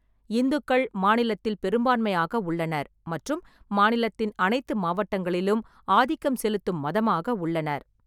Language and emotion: Tamil, neutral